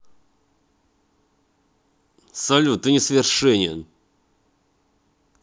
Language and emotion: Russian, angry